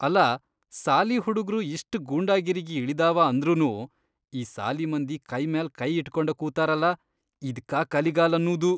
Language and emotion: Kannada, disgusted